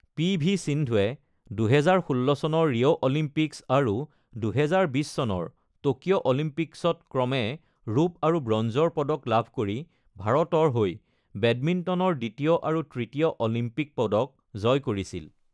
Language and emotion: Assamese, neutral